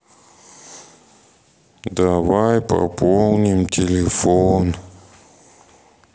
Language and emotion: Russian, sad